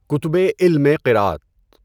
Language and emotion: Urdu, neutral